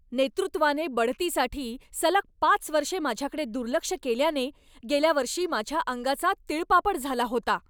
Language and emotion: Marathi, angry